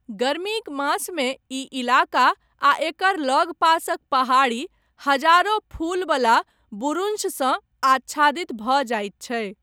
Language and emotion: Maithili, neutral